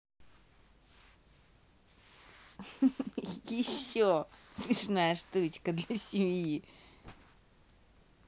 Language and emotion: Russian, positive